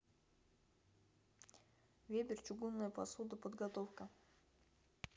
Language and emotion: Russian, neutral